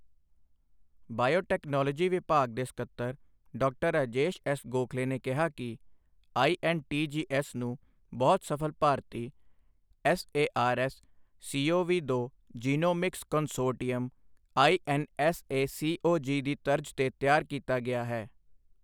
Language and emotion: Punjabi, neutral